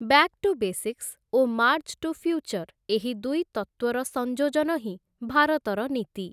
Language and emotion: Odia, neutral